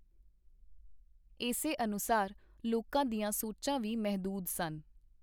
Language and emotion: Punjabi, neutral